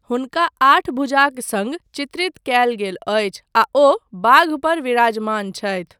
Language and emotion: Maithili, neutral